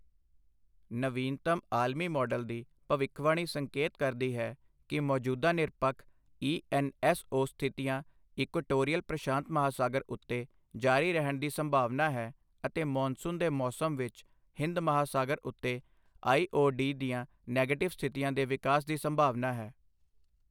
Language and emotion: Punjabi, neutral